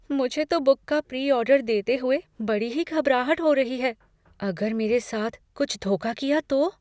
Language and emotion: Hindi, fearful